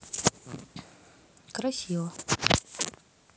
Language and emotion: Russian, neutral